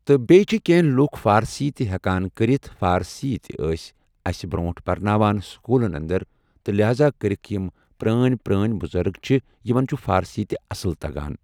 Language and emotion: Kashmiri, neutral